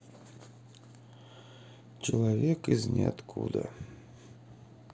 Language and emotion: Russian, sad